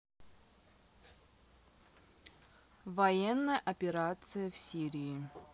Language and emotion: Russian, neutral